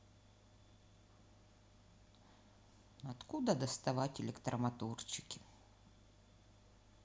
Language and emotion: Russian, sad